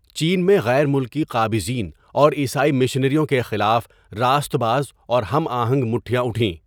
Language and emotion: Urdu, neutral